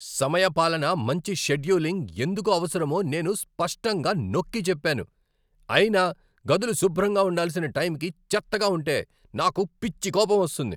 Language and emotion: Telugu, angry